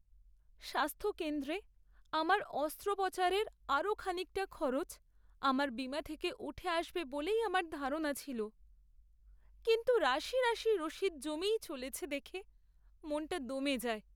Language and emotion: Bengali, sad